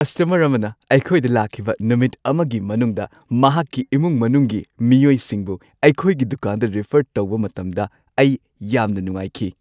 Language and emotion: Manipuri, happy